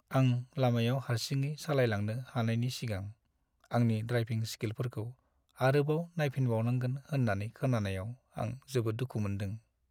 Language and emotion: Bodo, sad